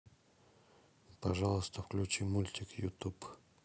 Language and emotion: Russian, neutral